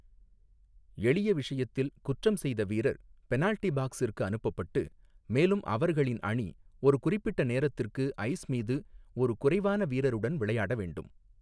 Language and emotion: Tamil, neutral